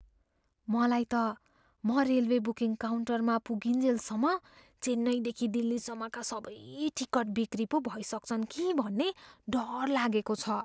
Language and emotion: Nepali, fearful